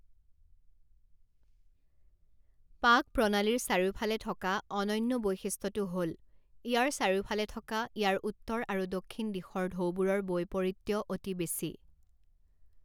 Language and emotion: Assamese, neutral